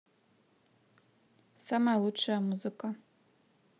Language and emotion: Russian, neutral